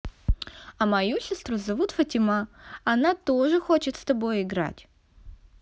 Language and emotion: Russian, positive